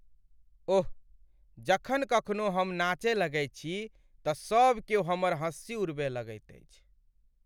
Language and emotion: Maithili, sad